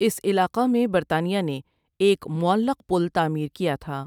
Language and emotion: Urdu, neutral